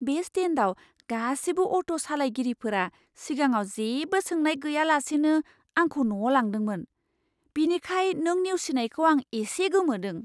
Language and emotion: Bodo, surprised